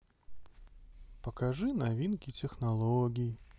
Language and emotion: Russian, sad